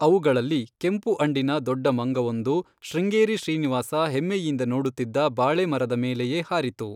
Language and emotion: Kannada, neutral